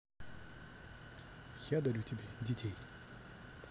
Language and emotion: Russian, positive